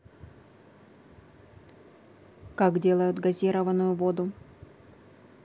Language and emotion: Russian, neutral